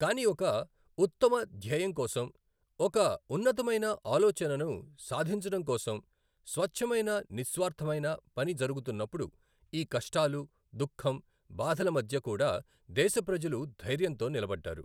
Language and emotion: Telugu, neutral